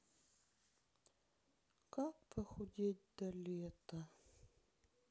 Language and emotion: Russian, sad